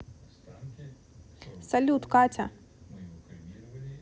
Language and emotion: Russian, neutral